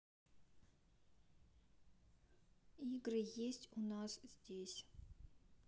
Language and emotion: Russian, neutral